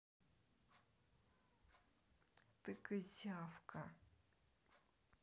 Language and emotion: Russian, neutral